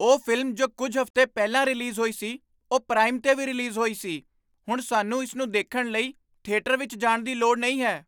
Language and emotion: Punjabi, surprised